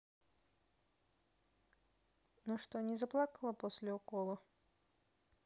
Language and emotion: Russian, neutral